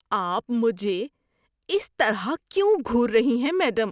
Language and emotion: Urdu, disgusted